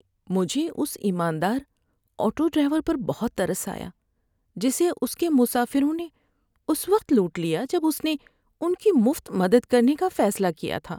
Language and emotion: Urdu, sad